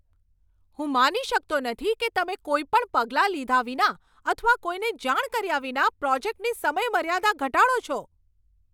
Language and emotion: Gujarati, angry